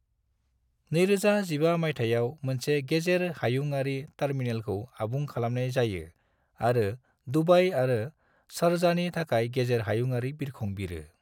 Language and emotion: Bodo, neutral